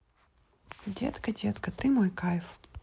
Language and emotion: Russian, neutral